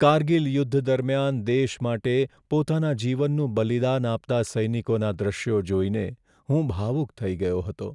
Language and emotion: Gujarati, sad